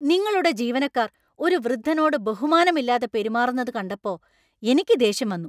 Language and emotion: Malayalam, angry